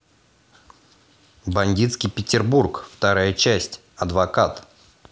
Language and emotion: Russian, positive